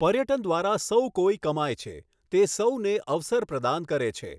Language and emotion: Gujarati, neutral